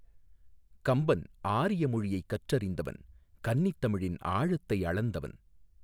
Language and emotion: Tamil, neutral